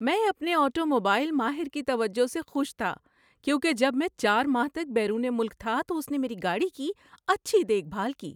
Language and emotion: Urdu, happy